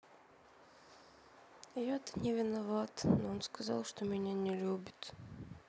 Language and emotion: Russian, sad